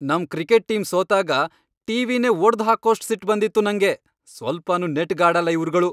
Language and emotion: Kannada, angry